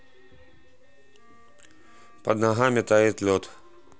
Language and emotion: Russian, neutral